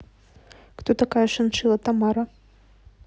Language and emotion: Russian, neutral